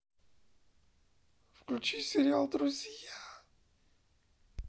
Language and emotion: Russian, sad